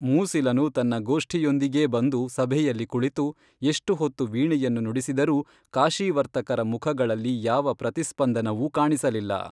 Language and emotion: Kannada, neutral